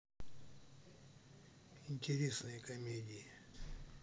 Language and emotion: Russian, neutral